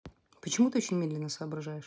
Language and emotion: Russian, neutral